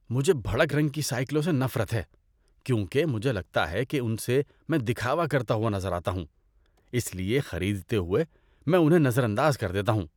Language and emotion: Urdu, disgusted